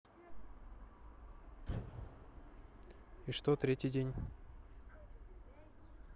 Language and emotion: Russian, neutral